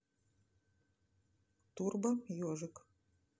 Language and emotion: Russian, neutral